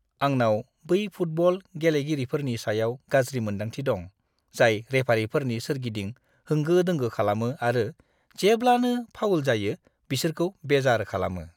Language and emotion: Bodo, disgusted